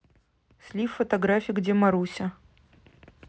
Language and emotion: Russian, neutral